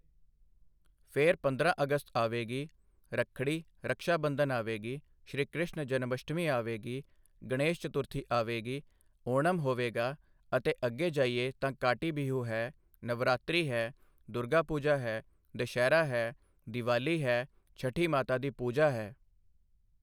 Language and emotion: Punjabi, neutral